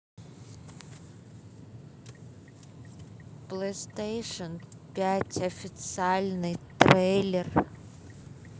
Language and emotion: Russian, neutral